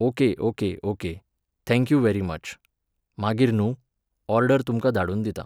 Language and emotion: Goan Konkani, neutral